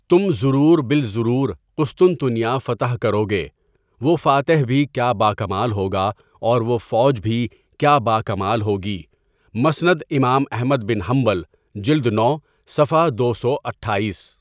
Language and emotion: Urdu, neutral